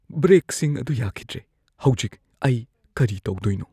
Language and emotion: Manipuri, fearful